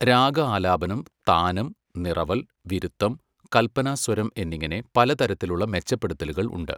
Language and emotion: Malayalam, neutral